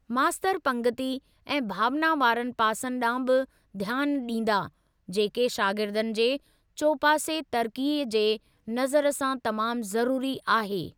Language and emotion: Sindhi, neutral